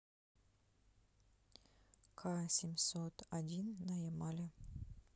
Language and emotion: Russian, neutral